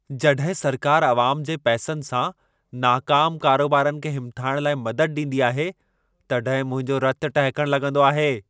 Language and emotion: Sindhi, angry